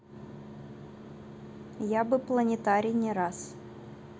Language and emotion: Russian, neutral